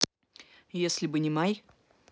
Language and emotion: Russian, neutral